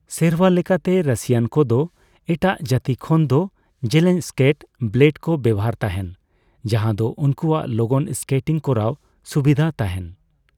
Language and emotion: Santali, neutral